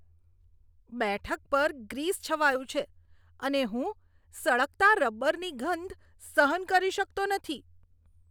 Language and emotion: Gujarati, disgusted